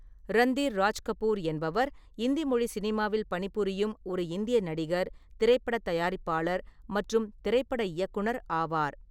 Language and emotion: Tamil, neutral